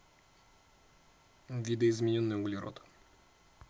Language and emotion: Russian, neutral